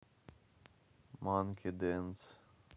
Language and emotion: Russian, neutral